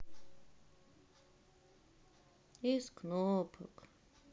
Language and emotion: Russian, sad